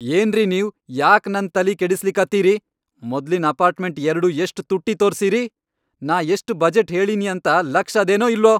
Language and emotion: Kannada, angry